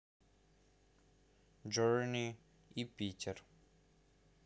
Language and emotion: Russian, neutral